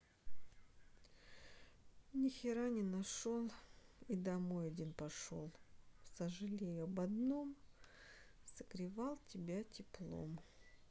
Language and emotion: Russian, sad